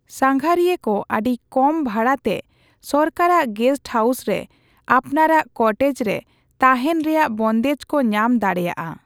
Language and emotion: Santali, neutral